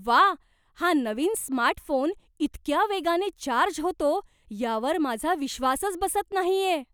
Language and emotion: Marathi, surprised